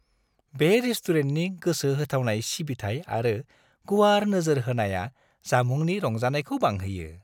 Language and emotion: Bodo, happy